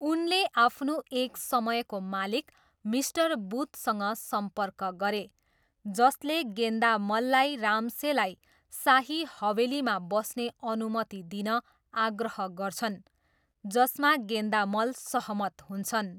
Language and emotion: Nepali, neutral